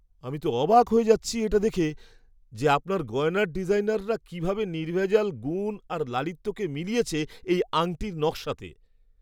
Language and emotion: Bengali, surprised